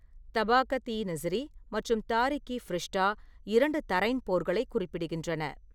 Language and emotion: Tamil, neutral